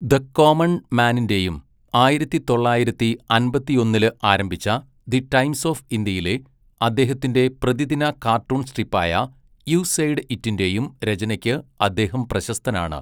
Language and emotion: Malayalam, neutral